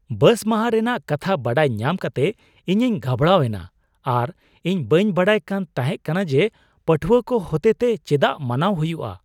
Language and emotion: Santali, surprised